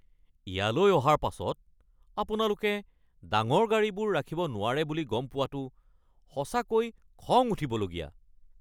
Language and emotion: Assamese, angry